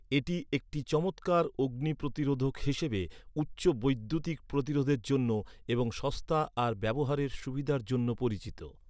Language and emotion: Bengali, neutral